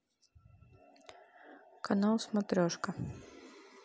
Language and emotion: Russian, neutral